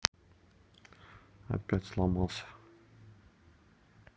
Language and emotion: Russian, neutral